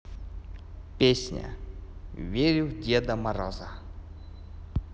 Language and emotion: Russian, positive